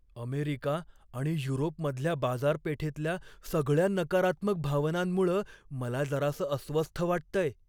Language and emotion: Marathi, fearful